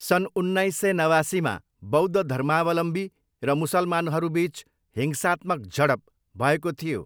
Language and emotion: Nepali, neutral